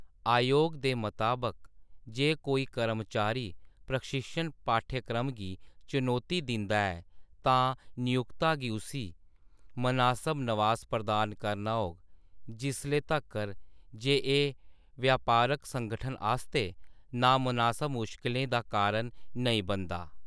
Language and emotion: Dogri, neutral